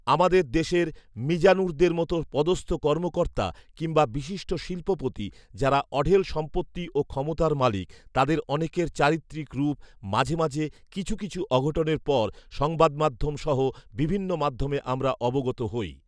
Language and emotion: Bengali, neutral